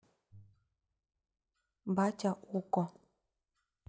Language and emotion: Russian, neutral